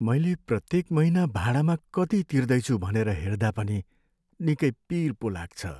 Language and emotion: Nepali, sad